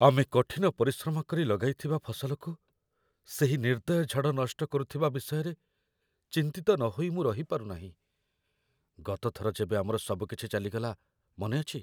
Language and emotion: Odia, fearful